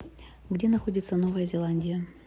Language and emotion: Russian, neutral